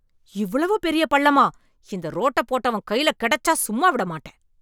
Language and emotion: Tamil, angry